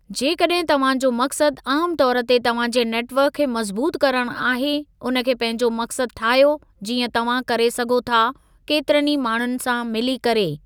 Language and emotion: Sindhi, neutral